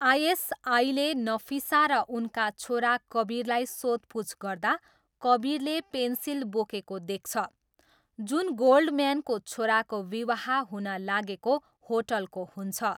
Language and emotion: Nepali, neutral